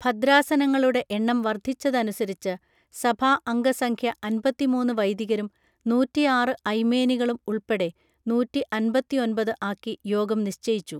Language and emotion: Malayalam, neutral